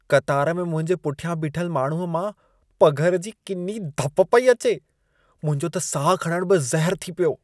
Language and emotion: Sindhi, disgusted